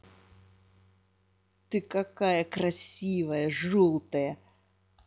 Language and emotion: Russian, angry